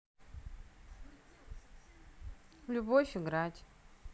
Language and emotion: Russian, neutral